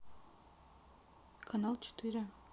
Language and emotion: Russian, neutral